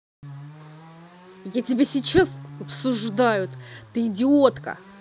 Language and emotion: Russian, angry